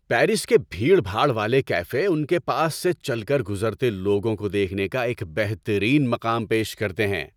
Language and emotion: Urdu, happy